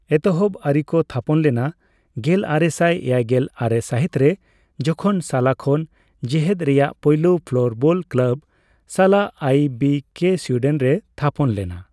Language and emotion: Santali, neutral